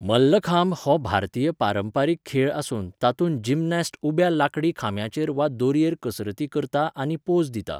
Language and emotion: Goan Konkani, neutral